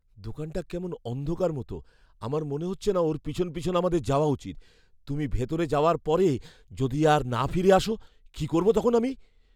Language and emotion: Bengali, fearful